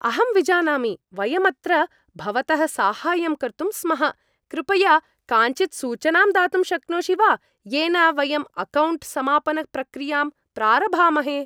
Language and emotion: Sanskrit, happy